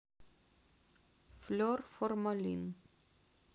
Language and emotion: Russian, neutral